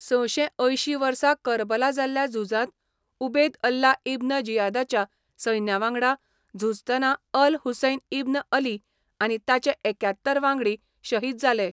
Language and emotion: Goan Konkani, neutral